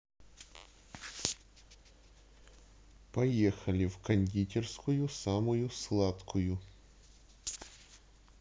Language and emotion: Russian, neutral